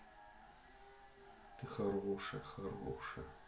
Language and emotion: Russian, neutral